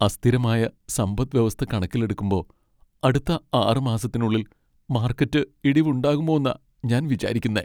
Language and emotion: Malayalam, sad